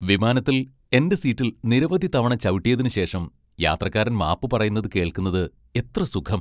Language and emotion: Malayalam, happy